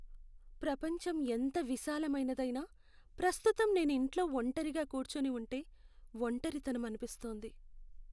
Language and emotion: Telugu, sad